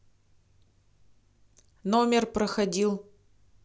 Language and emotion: Russian, neutral